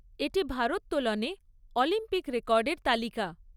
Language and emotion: Bengali, neutral